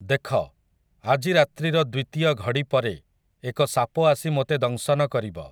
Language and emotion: Odia, neutral